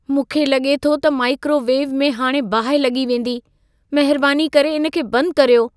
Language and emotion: Sindhi, fearful